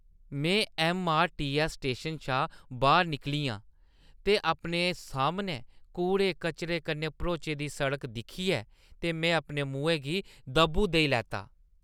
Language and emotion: Dogri, disgusted